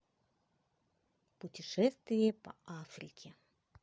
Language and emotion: Russian, neutral